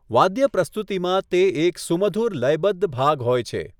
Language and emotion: Gujarati, neutral